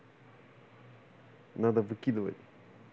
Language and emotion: Russian, neutral